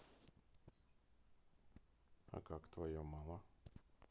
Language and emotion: Russian, neutral